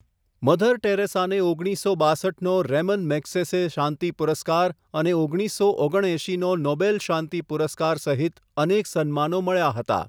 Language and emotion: Gujarati, neutral